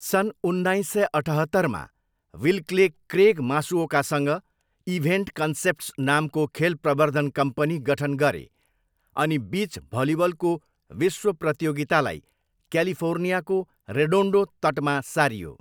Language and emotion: Nepali, neutral